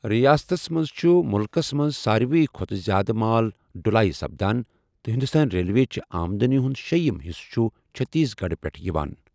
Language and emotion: Kashmiri, neutral